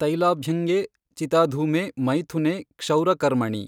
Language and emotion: Kannada, neutral